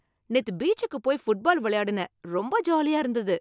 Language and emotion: Tamil, happy